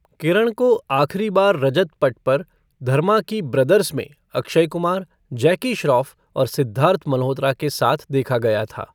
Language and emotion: Hindi, neutral